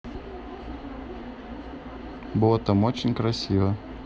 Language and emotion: Russian, neutral